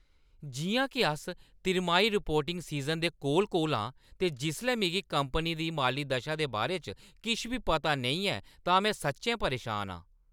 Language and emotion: Dogri, angry